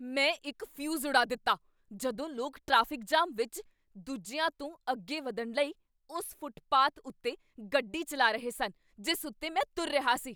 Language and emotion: Punjabi, angry